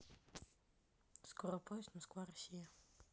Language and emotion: Russian, neutral